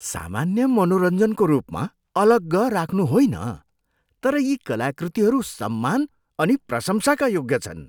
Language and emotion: Nepali, disgusted